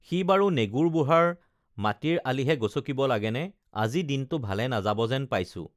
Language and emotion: Assamese, neutral